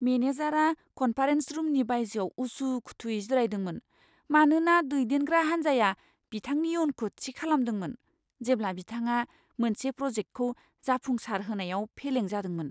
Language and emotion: Bodo, fearful